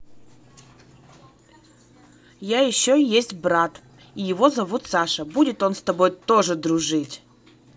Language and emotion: Russian, positive